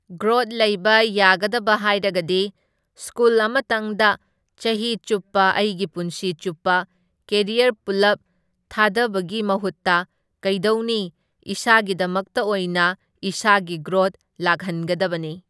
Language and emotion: Manipuri, neutral